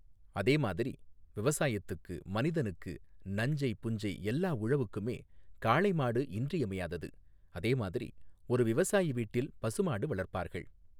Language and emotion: Tamil, neutral